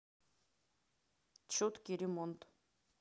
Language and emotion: Russian, neutral